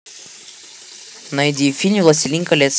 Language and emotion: Russian, neutral